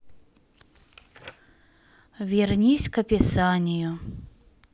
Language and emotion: Russian, sad